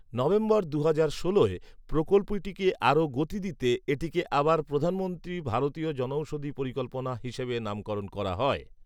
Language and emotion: Bengali, neutral